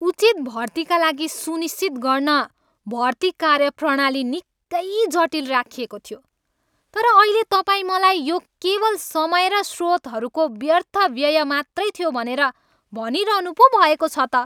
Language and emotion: Nepali, angry